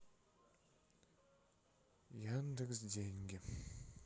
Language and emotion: Russian, sad